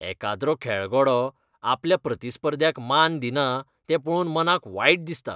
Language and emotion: Goan Konkani, disgusted